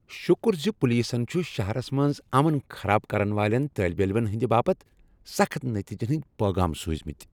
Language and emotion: Kashmiri, happy